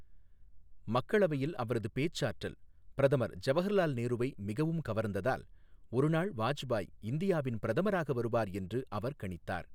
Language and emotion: Tamil, neutral